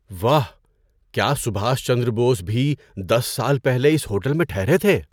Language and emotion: Urdu, surprised